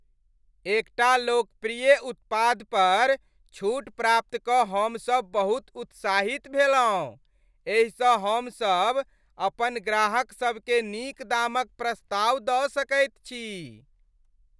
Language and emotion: Maithili, happy